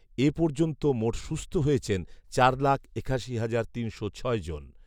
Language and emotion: Bengali, neutral